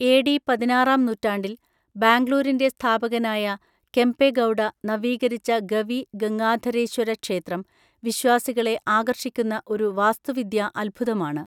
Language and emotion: Malayalam, neutral